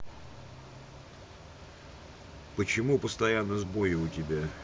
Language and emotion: Russian, neutral